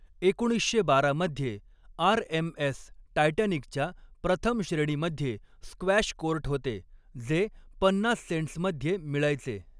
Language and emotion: Marathi, neutral